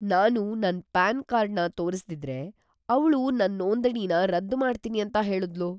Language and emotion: Kannada, fearful